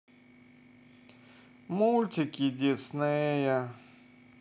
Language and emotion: Russian, sad